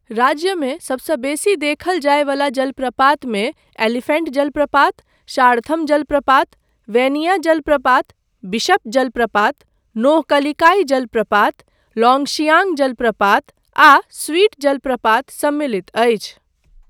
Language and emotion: Maithili, neutral